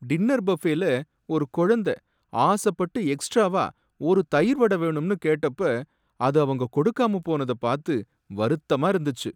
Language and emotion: Tamil, sad